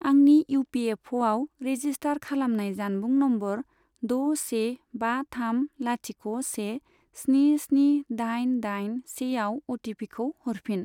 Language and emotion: Bodo, neutral